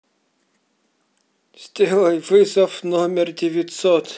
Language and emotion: Russian, neutral